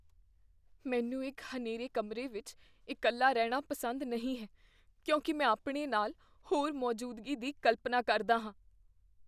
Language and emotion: Punjabi, fearful